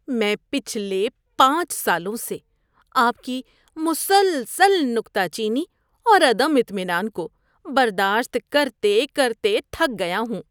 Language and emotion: Urdu, disgusted